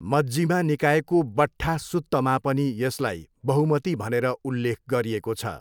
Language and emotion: Nepali, neutral